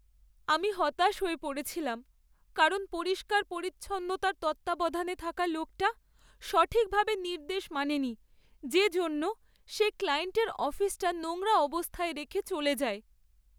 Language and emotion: Bengali, sad